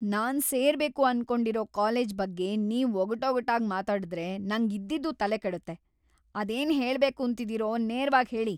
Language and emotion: Kannada, angry